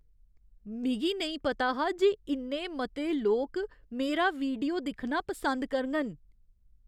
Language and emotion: Dogri, surprised